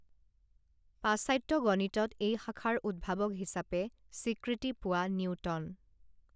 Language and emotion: Assamese, neutral